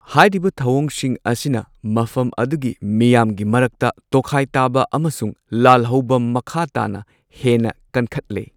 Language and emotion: Manipuri, neutral